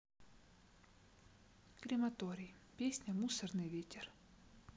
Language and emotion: Russian, neutral